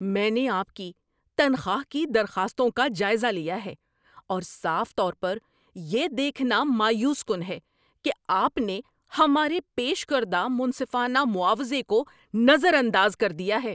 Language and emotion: Urdu, angry